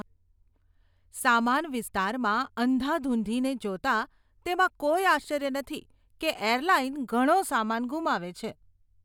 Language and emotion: Gujarati, disgusted